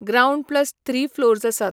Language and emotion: Goan Konkani, neutral